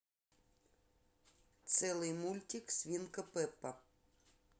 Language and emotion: Russian, neutral